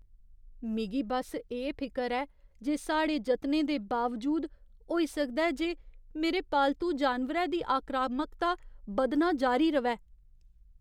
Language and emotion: Dogri, fearful